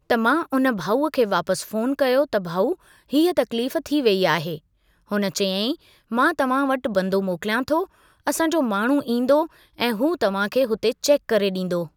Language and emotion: Sindhi, neutral